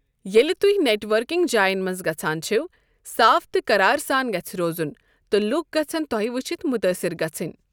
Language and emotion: Kashmiri, neutral